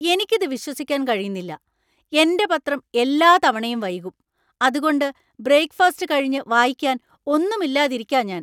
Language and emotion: Malayalam, angry